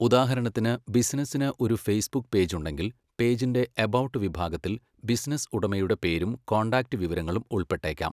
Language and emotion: Malayalam, neutral